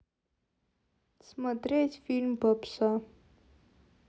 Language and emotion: Russian, neutral